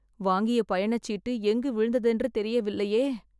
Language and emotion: Tamil, sad